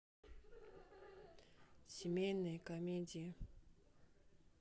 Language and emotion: Russian, neutral